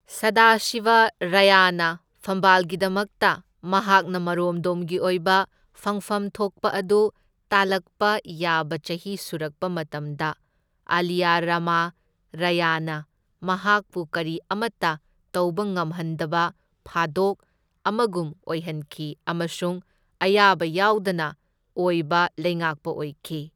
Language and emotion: Manipuri, neutral